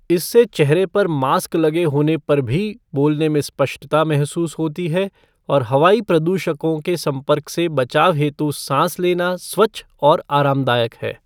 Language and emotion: Hindi, neutral